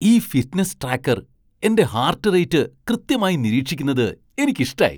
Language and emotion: Malayalam, surprised